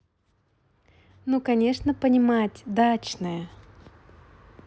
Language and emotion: Russian, positive